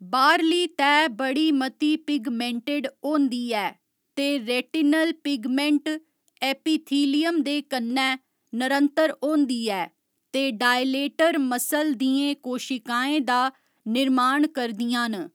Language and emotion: Dogri, neutral